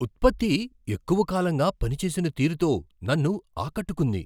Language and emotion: Telugu, surprised